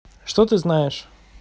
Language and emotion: Russian, neutral